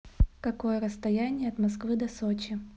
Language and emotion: Russian, neutral